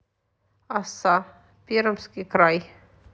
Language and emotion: Russian, neutral